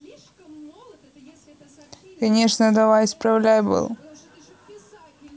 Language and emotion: Russian, neutral